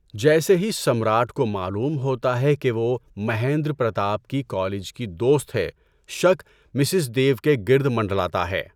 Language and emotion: Urdu, neutral